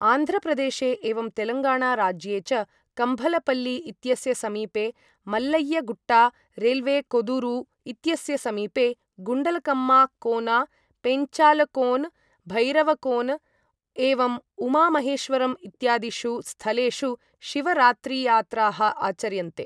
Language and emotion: Sanskrit, neutral